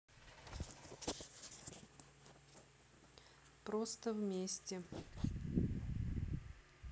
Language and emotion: Russian, neutral